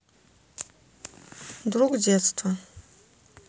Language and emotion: Russian, neutral